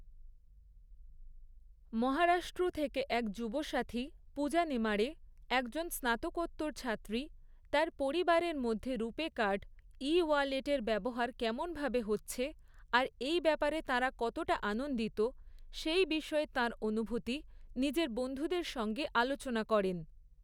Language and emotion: Bengali, neutral